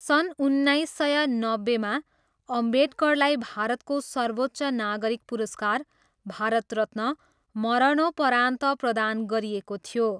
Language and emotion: Nepali, neutral